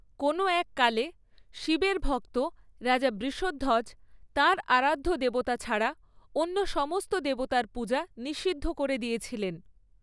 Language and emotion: Bengali, neutral